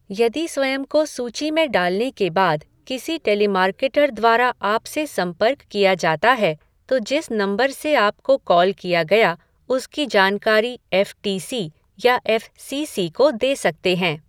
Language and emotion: Hindi, neutral